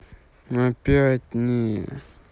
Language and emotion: Russian, sad